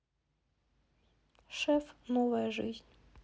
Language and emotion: Russian, neutral